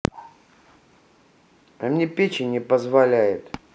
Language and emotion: Russian, neutral